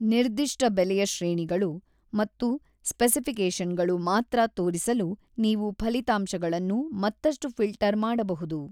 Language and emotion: Kannada, neutral